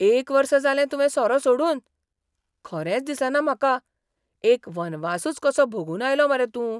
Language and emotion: Goan Konkani, surprised